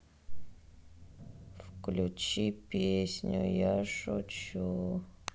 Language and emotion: Russian, sad